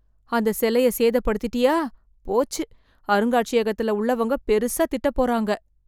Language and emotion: Tamil, fearful